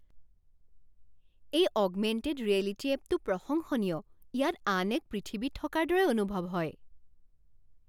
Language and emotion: Assamese, surprised